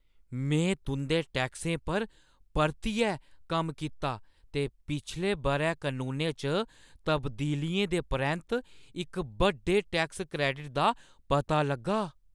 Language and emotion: Dogri, surprised